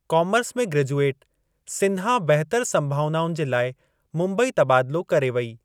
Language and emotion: Sindhi, neutral